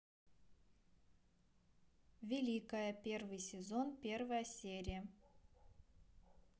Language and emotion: Russian, neutral